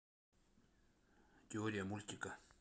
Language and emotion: Russian, neutral